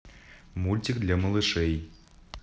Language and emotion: Russian, neutral